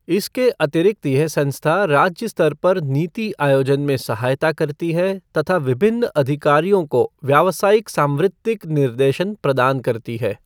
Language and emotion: Hindi, neutral